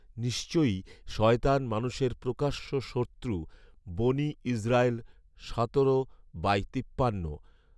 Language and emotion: Bengali, neutral